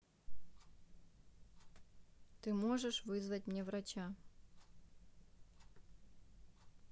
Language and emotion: Russian, neutral